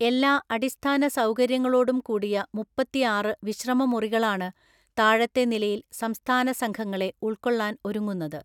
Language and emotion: Malayalam, neutral